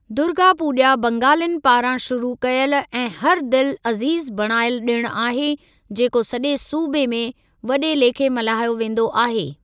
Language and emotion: Sindhi, neutral